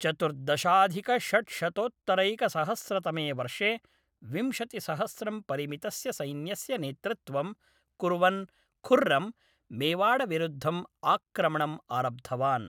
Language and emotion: Sanskrit, neutral